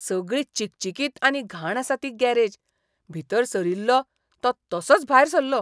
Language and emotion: Goan Konkani, disgusted